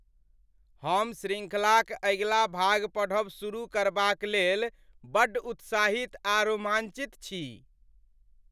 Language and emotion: Maithili, happy